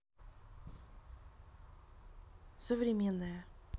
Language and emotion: Russian, neutral